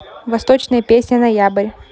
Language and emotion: Russian, neutral